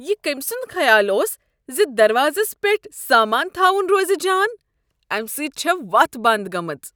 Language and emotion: Kashmiri, disgusted